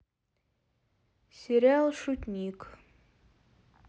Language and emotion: Russian, neutral